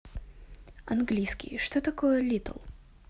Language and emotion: Russian, neutral